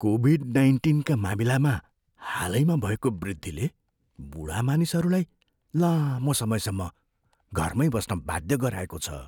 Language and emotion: Nepali, fearful